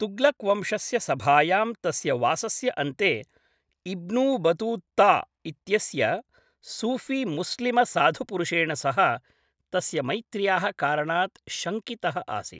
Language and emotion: Sanskrit, neutral